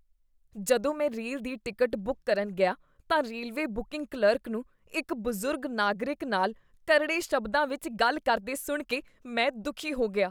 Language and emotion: Punjabi, disgusted